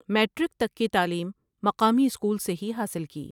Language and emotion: Urdu, neutral